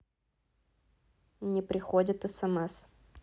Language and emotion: Russian, neutral